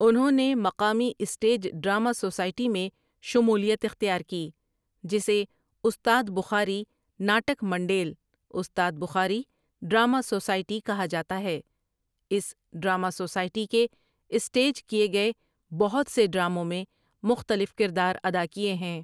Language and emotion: Urdu, neutral